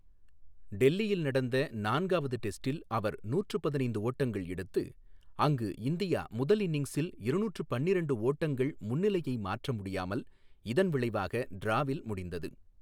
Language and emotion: Tamil, neutral